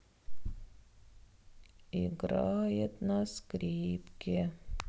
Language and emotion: Russian, sad